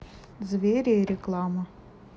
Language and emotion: Russian, neutral